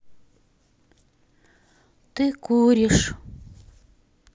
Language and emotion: Russian, sad